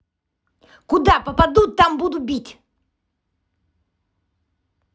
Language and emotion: Russian, angry